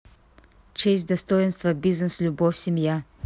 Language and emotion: Russian, neutral